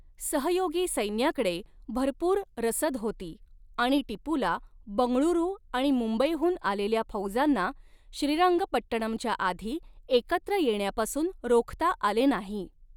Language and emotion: Marathi, neutral